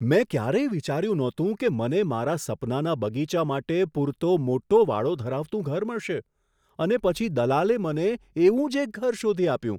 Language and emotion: Gujarati, surprised